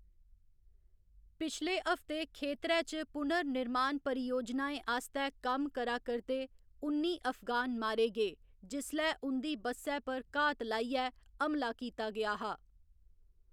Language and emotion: Dogri, neutral